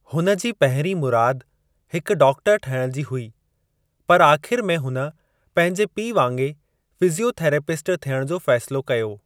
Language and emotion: Sindhi, neutral